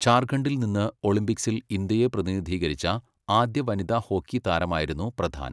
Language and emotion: Malayalam, neutral